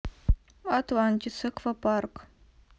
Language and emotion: Russian, neutral